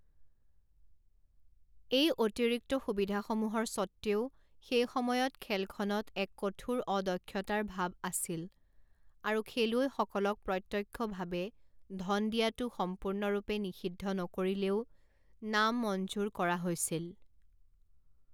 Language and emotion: Assamese, neutral